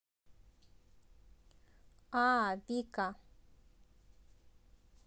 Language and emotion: Russian, positive